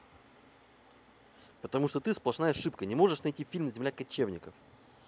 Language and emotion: Russian, angry